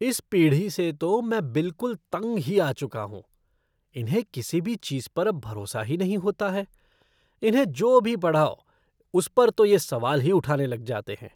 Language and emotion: Hindi, disgusted